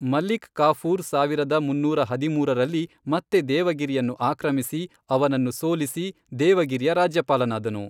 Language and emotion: Kannada, neutral